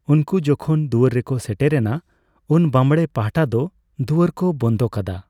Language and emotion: Santali, neutral